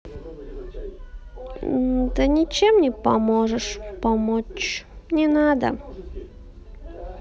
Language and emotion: Russian, sad